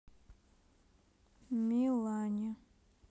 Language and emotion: Russian, neutral